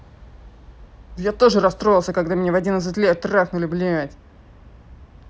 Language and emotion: Russian, angry